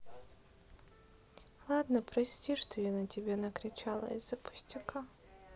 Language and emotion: Russian, sad